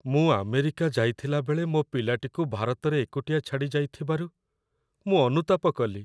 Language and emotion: Odia, sad